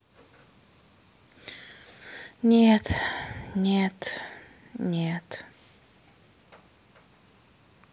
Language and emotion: Russian, sad